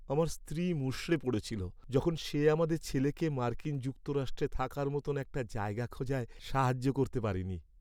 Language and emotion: Bengali, sad